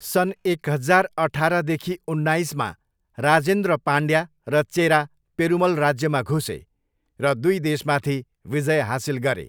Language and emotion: Nepali, neutral